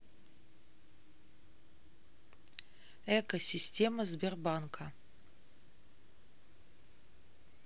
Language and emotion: Russian, neutral